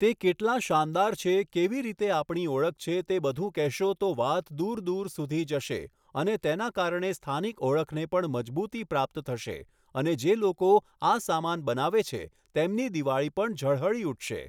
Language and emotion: Gujarati, neutral